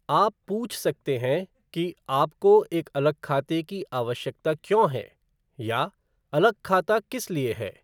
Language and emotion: Hindi, neutral